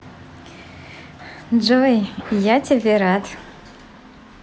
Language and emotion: Russian, positive